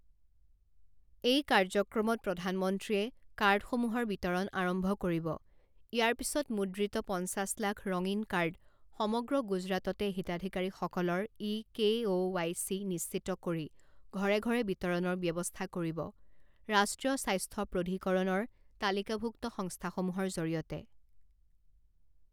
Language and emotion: Assamese, neutral